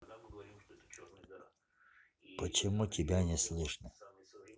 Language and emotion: Russian, neutral